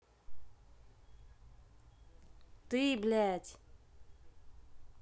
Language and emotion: Russian, angry